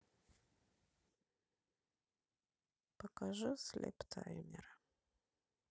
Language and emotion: Russian, sad